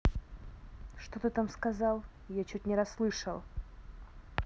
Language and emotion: Russian, angry